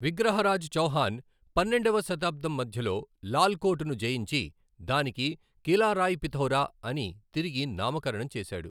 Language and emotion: Telugu, neutral